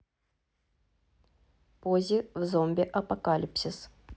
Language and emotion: Russian, neutral